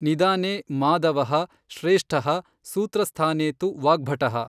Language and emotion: Kannada, neutral